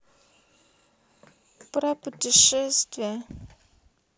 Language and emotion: Russian, sad